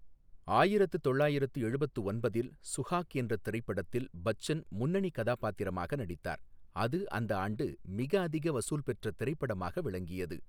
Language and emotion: Tamil, neutral